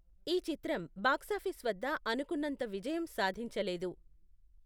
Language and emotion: Telugu, neutral